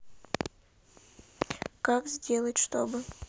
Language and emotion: Russian, neutral